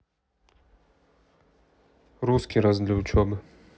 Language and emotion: Russian, neutral